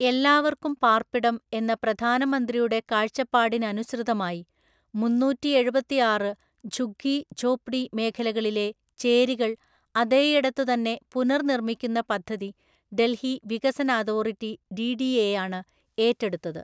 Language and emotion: Malayalam, neutral